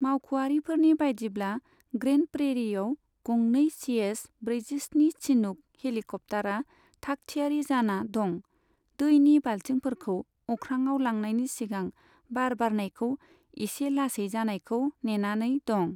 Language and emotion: Bodo, neutral